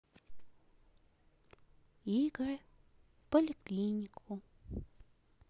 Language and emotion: Russian, neutral